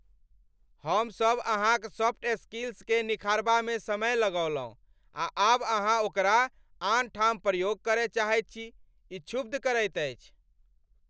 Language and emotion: Maithili, angry